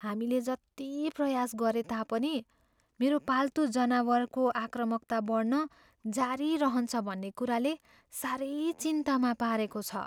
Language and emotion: Nepali, fearful